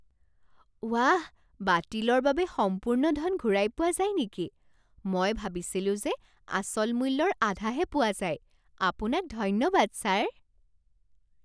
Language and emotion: Assamese, surprised